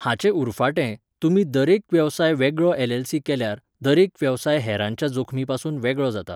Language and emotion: Goan Konkani, neutral